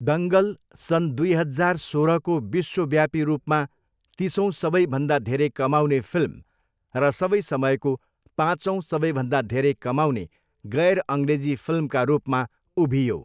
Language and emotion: Nepali, neutral